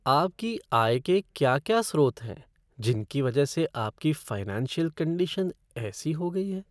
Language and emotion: Hindi, sad